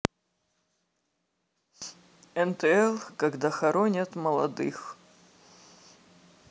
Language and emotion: Russian, sad